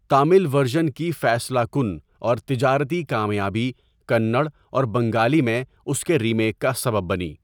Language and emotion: Urdu, neutral